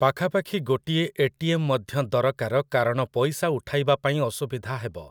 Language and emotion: Odia, neutral